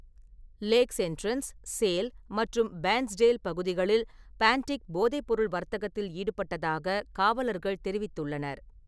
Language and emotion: Tamil, neutral